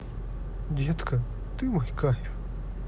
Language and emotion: Russian, positive